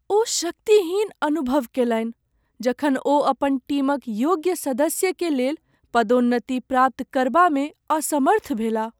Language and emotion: Maithili, sad